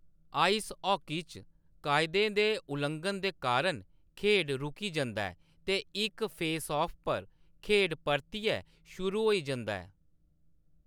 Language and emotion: Dogri, neutral